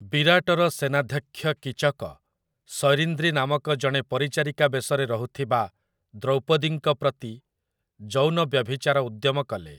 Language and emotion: Odia, neutral